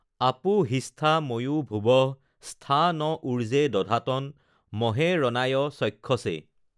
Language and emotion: Assamese, neutral